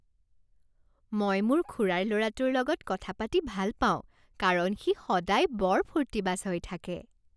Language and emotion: Assamese, happy